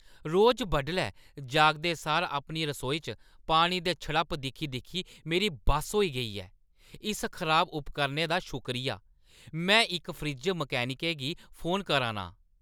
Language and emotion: Dogri, angry